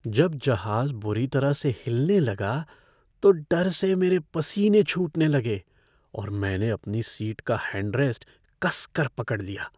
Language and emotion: Hindi, fearful